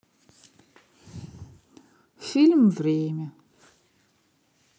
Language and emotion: Russian, sad